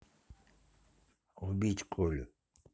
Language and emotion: Russian, neutral